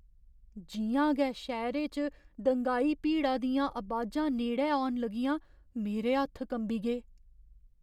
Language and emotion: Dogri, fearful